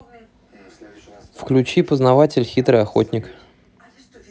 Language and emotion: Russian, neutral